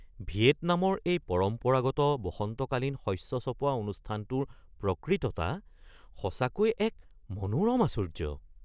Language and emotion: Assamese, surprised